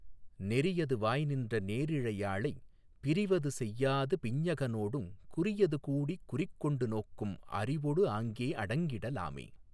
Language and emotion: Tamil, neutral